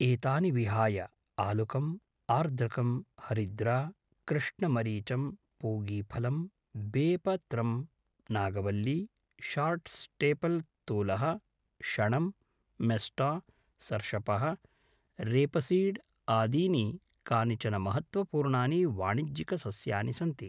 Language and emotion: Sanskrit, neutral